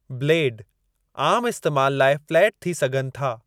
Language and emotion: Sindhi, neutral